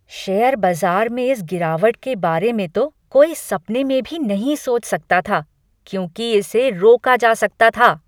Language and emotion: Hindi, angry